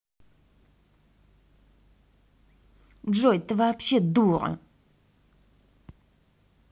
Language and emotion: Russian, angry